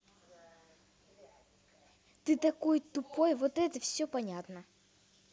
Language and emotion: Russian, angry